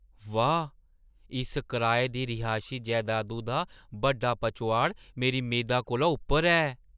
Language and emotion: Dogri, surprised